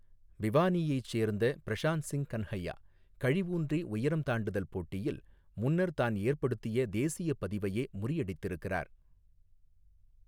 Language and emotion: Tamil, neutral